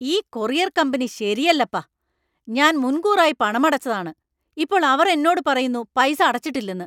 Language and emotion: Malayalam, angry